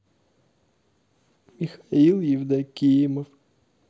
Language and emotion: Russian, sad